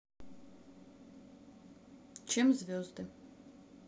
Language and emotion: Russian, neutral